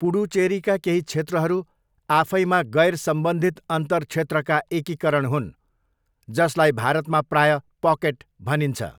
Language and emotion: Nepali, neutral